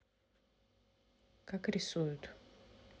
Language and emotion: Russian, neutral